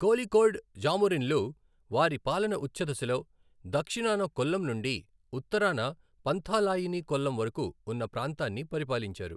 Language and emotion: Telugu, neutral